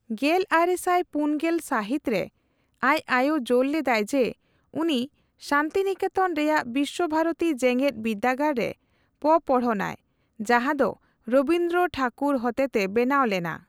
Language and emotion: Santali, neutral